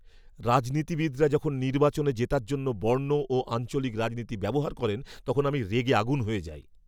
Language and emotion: Bengali, angry